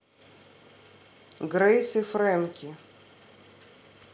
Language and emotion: Russian, neutral